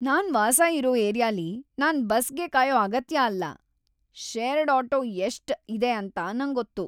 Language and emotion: Kannada, happy